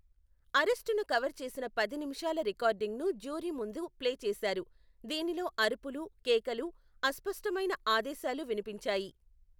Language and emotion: Telugu, neutral